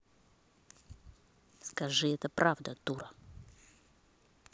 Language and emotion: Russian, angry